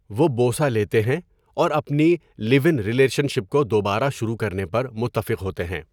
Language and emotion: Urdu, neutral